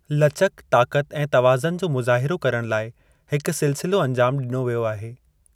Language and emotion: Sindhi, neutral